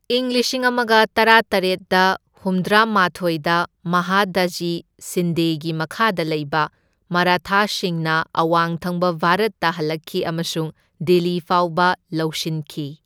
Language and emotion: Manipuri, neutral